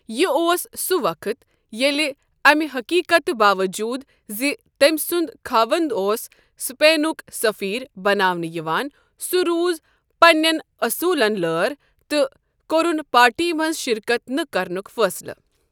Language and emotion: Kashmiri, neutral